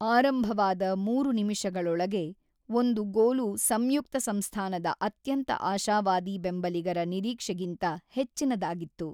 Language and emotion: Kannada, neutral